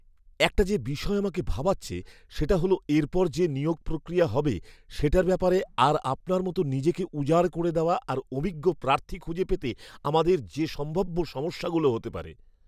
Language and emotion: Bengali, fearful